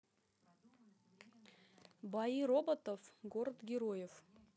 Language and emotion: Russian, neutral